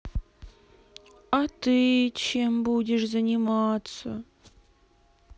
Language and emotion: Russian, sad